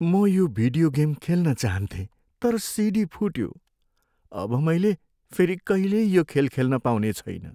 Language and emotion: Nepali, sad